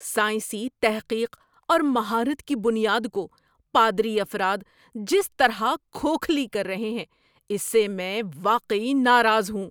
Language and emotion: Urdu, angry